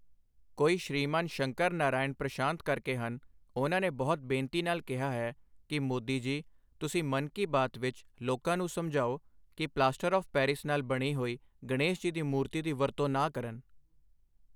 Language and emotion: Punjabi, neutral